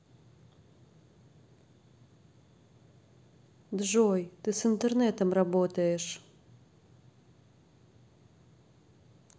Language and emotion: Russian, neutral